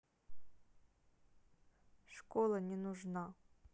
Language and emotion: Russian, neutral